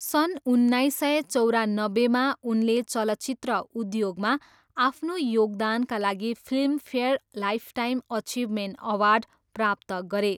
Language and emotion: Nepali, neutral